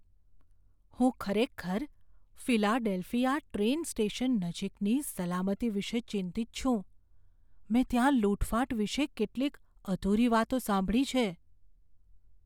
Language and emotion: Gujarati, fearful